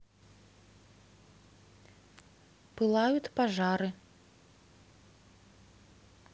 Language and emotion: Russian, neutral